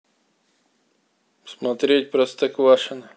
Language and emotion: Russian, neutral